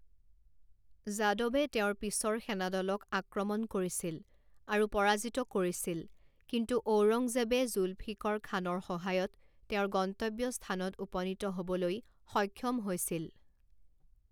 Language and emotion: Assamese, neutral